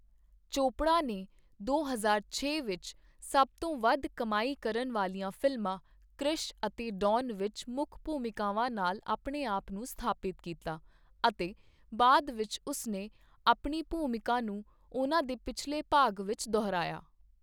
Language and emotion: Punjabi, neutral